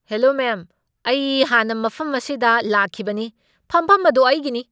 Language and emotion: Manipuri, angry